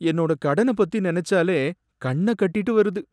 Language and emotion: Tamil, sad